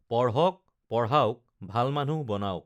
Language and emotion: Assamese, neutral